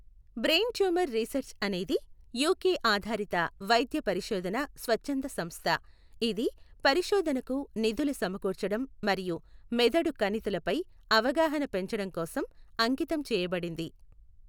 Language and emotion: Telugu, neutral